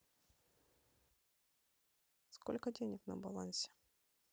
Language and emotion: Russian, neutral